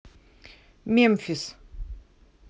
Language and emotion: Russian, neutral